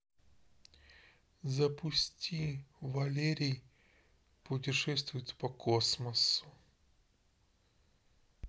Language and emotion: Russian, neutral